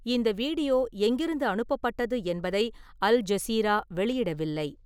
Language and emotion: Tamil, neutral